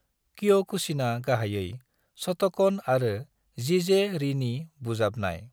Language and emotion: Bodo, neutral